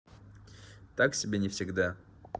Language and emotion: Russian, neutral